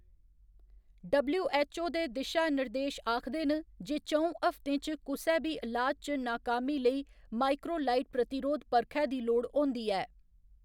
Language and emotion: Dogri, neutral